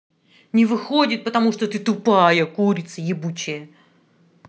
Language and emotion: Russian, angry